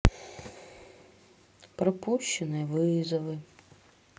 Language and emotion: Russian, sad